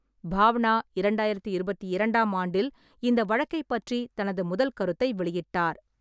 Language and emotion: Tamil, neutral